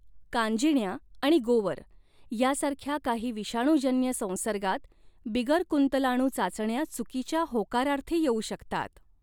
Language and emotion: Marathi, neutral